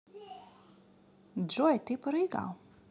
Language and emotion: Russian, positive